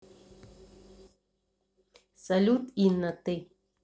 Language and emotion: Russian, neutral